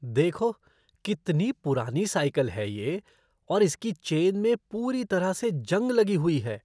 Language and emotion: Hindi, disgusted